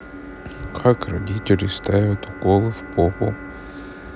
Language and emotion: Russian, neutral